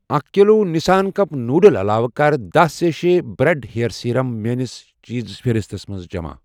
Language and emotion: Kashmiri, neutral